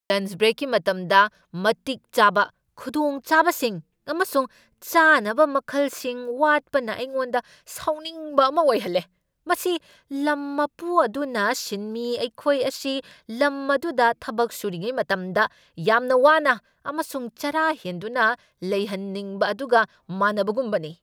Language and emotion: Manipuri, angry